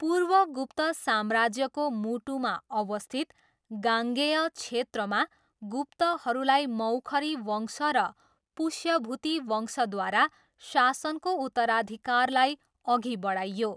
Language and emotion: Nepali, neutral